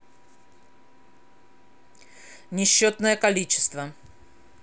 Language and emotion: Russian, angry